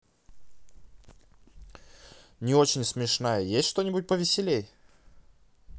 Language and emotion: Russian, neutral